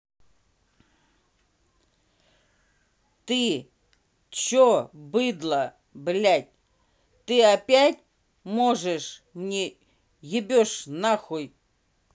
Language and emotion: Russian, angry